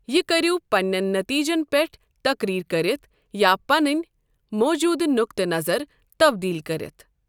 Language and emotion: Kashmiri, neutral